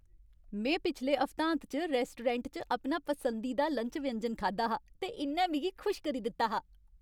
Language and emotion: Dogri, happy